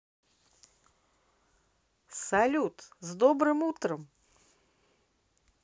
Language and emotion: Russian, positive